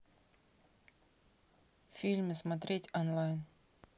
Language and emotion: Russian, neutral